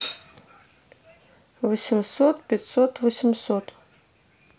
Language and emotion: Russian, neutral